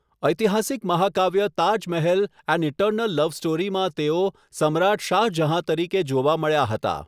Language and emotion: Gujarati, neutral